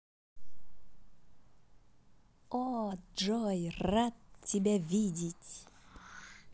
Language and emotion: Russian, positive